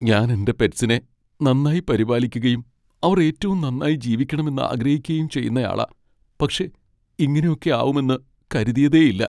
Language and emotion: Malayalam, sad